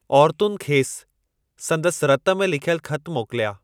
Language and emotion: Sindhi, neutral